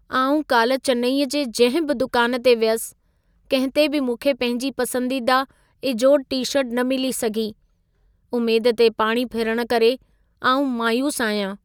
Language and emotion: Sindhi, sad